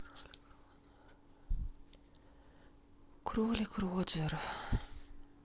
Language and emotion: Russian, sad